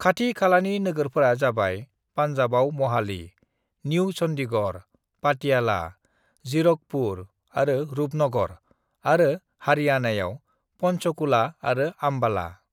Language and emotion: Bodo, neutral